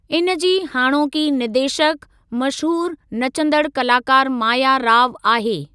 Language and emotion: Sindhi, neutral